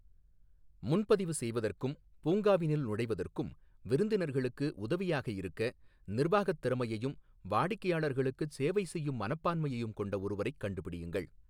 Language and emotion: Tamil, neutral